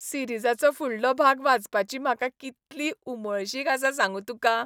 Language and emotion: Goan Konkani, happy